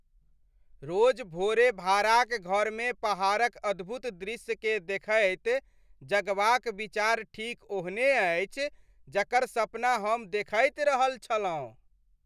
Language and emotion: Maithili, happy